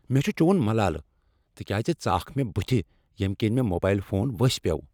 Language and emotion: Kashmiri, angry